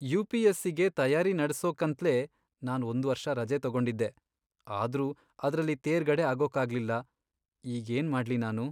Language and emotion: Kannada, sad